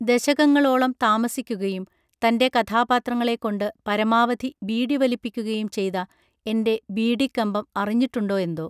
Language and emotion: Malayalam, neutral